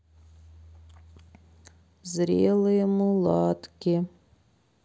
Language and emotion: Russian, sad